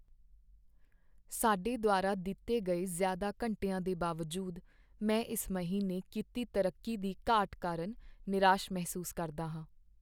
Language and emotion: Punjabi, sad